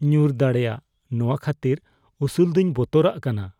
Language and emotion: Santali, fearful